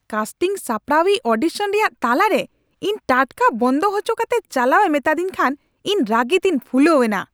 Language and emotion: Santali, angry